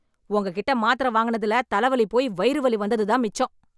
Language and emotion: Tamil, angry